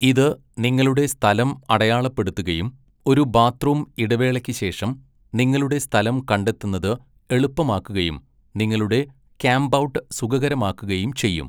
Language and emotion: Malayalam, neutral